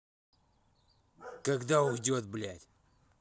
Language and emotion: Russian, angry